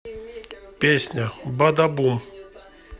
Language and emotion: Russian, neutral